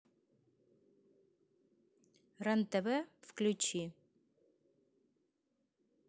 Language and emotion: Russian, neutral